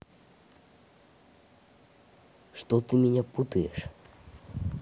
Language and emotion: Russian, neutral